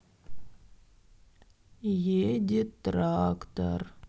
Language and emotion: Russian, sad